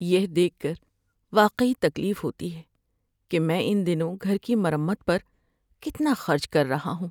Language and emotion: Urdu, sad